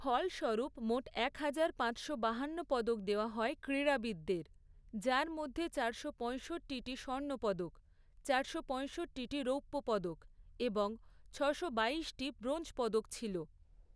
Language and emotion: Bengali, neutral